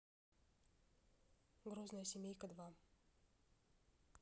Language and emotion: Russian, neutral